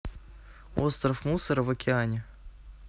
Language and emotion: Russian, neutral